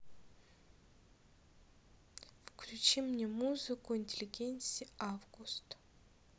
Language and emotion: Russian, neutral